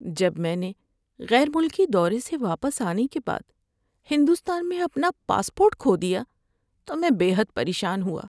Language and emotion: Urdu, sad